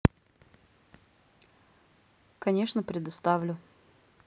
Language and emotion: Russian, neutral